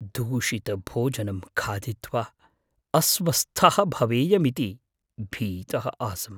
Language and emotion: Sanskrit, fearful